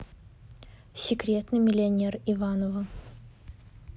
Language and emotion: Russian, neutral